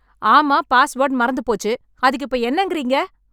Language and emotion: Tamil, angry